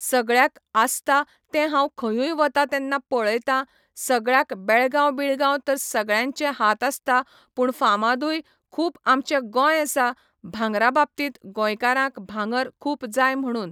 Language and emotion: Goan Konkani, neutral